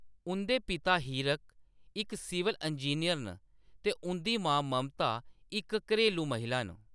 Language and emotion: Dogri, neutral